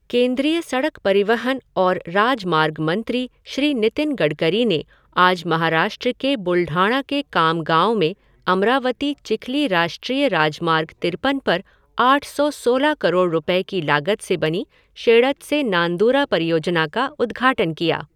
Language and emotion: Hindi, neutral